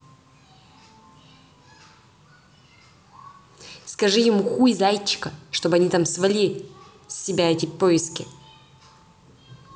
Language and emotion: Russian, angry